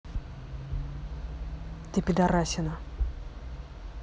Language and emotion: Russian, angry